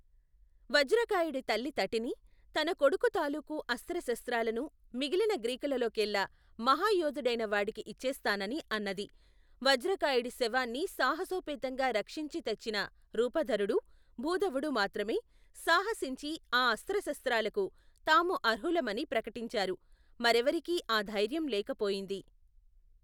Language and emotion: Telugu, neutral